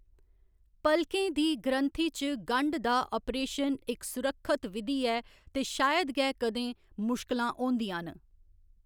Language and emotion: Dogri, neutral